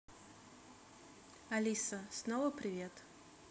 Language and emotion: Russian, neutral